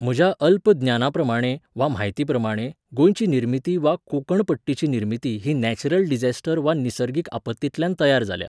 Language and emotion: Goan Konkani, neutral